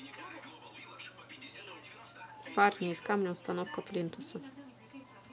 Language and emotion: Russian, neutral